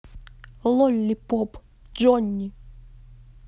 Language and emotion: Russian, neutral